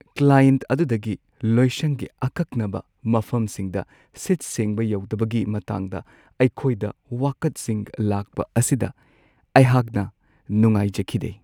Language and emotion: Manipuri, sad